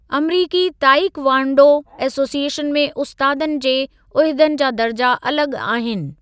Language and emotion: Sindhi, neutral